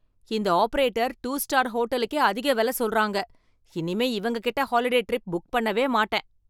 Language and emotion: Tamil, angry